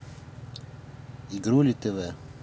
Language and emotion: Russian, neutral